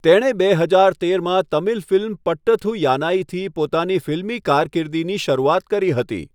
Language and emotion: Gujarati, neutral